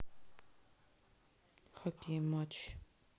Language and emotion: Russian, sad